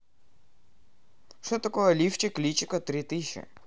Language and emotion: Russian, neutral